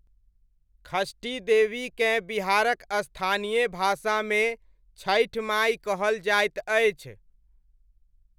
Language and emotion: Maithili, neutral